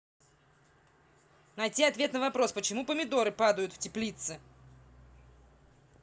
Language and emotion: Russian, angry